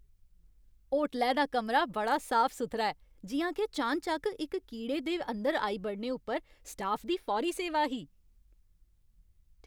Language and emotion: Dogri, happy